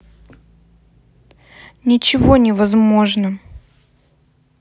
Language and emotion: Russian, sad